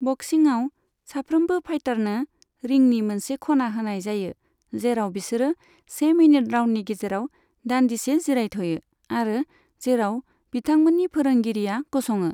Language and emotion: Bodo, neutral